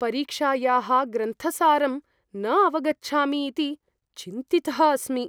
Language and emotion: Sanskrit, fearful